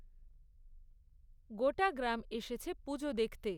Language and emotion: Bengali, neutral